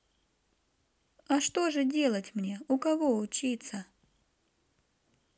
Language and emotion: Russian, neutral